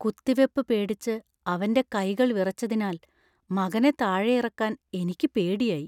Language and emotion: Malayalam, fearful